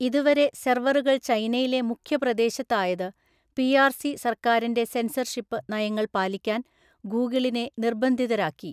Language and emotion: Malayalam, neutral